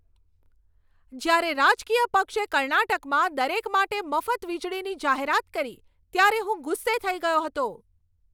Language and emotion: Gujarati, angry